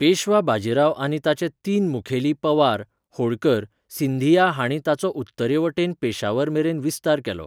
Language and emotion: Goan Konkani, neutral